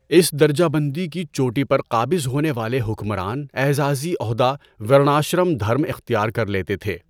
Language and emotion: Urdu, neutral